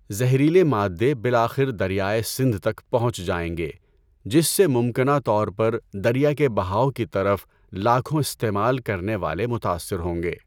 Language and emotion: Urdu, neutral